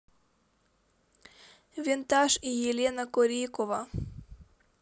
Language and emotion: Russian, neutral